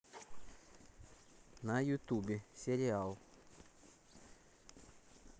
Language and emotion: Russian, neutral